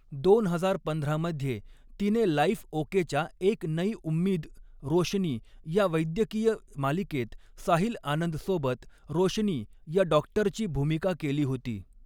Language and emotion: Marathi, neutral